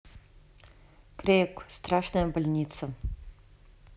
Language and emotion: Russian, neutral